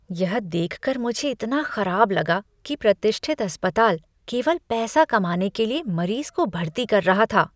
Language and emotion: Hindi, disgusted